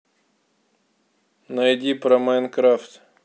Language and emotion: Russian, neutral